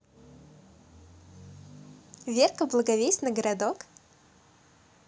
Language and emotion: Russian, positive